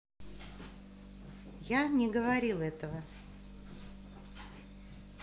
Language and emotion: Russian, neutral